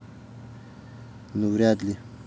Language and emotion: Russian, neutral